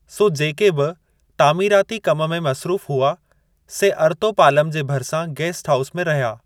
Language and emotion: Sindhi, neutral